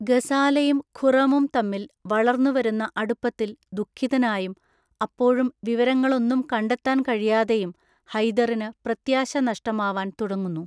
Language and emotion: Malayalam, neutral